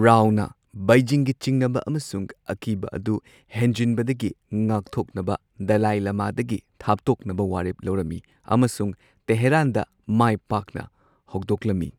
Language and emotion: Manipuri, neutral